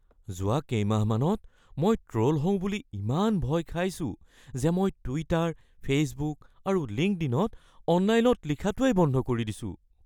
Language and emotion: Assamese, fearful